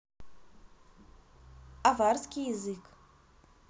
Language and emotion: Russian, neutral